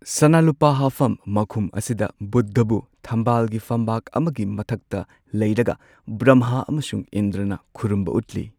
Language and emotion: Manipuri, neutral